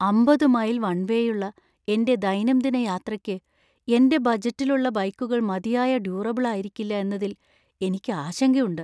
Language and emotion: Malayalam, fearful